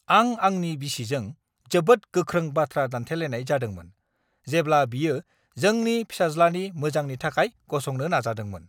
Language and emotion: Bodo, angry